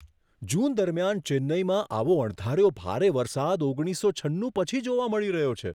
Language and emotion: Gujarati, surprised